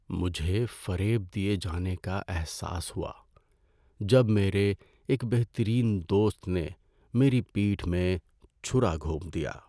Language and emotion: Urdu, sad